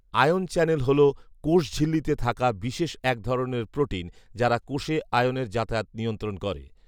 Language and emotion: Bengali, neutral